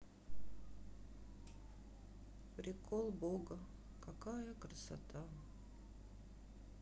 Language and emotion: Russian, sad